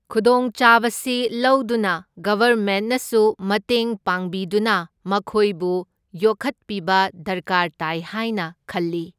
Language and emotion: Manipuri, neutral